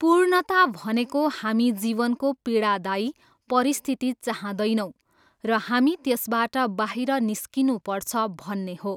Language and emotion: Nepali, neutral